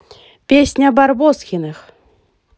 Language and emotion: Russian, positive